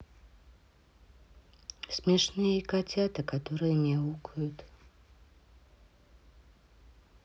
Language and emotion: Russian, neutral